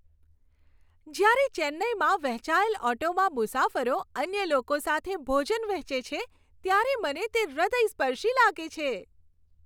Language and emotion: Gujarati, happy